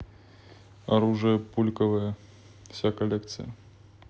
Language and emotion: Russian, neutral